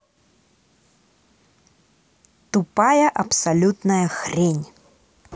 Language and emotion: Russian, angry